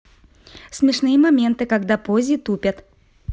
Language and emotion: Russian, positive